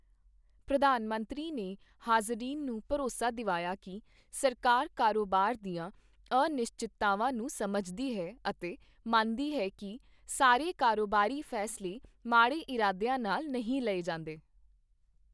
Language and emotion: Punjabi, neutral